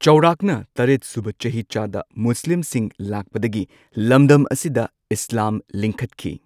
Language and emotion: Manipuri, neutral